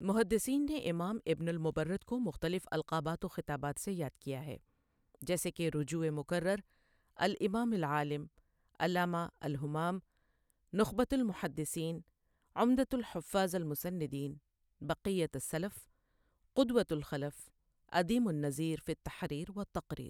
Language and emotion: Urdu, neutral